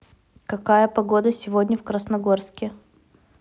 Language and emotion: Russian, neutral